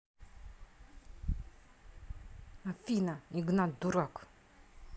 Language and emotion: Russian, angry